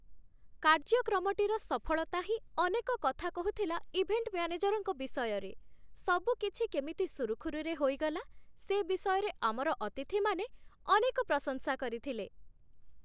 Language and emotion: Odia, happy